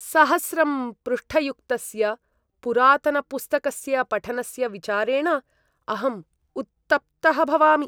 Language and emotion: Sanskrit, disgusted